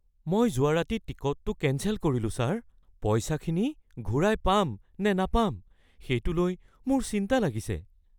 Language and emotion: Assamese, fearful